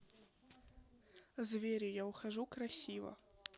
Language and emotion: Russian, neutral